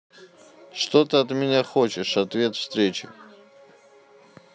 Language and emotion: Russian, neutral